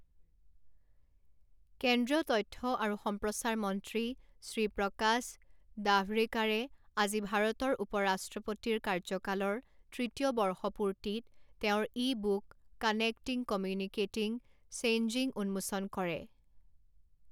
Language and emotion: Assamese, neutral